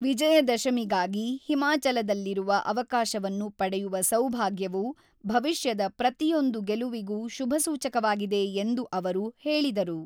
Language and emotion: Kannada, neutral